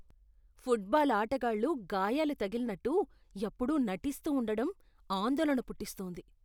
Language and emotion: Telugu, disgusted